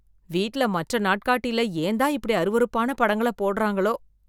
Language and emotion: Tamil, disgusted